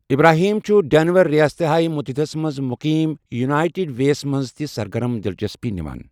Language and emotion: Kashmiri, neutral